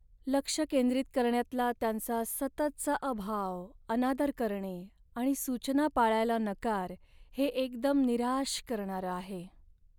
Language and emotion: Marathi, sad